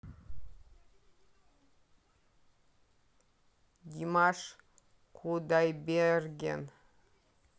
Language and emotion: Russian, neutral